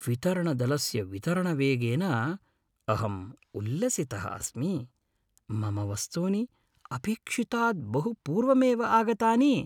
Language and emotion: Sanskrit, happy